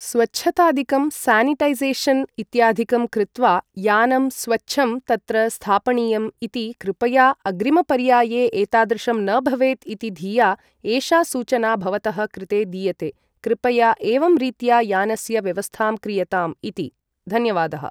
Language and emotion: Sanskrit, neutral